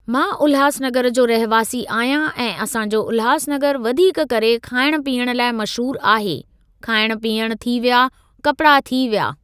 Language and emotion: Sindhi, neutral